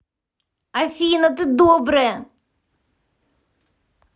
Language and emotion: Russian, neutral